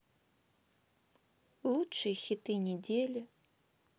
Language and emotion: Russian, sad